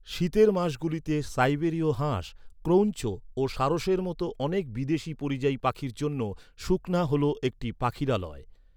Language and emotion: Bengali, neutral